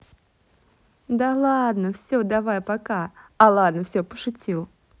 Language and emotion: Russian, positive